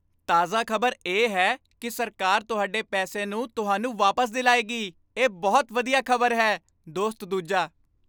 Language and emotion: Punjabi, happy